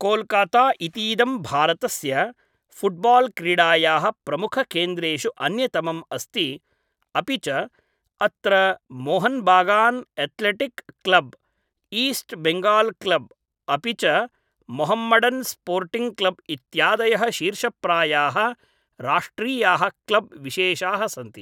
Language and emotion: Sanskrit, neutral